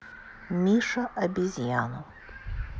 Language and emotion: Russian, neutral